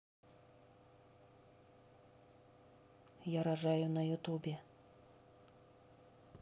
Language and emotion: Russian, neutral